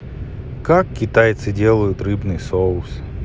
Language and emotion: Russian, neutral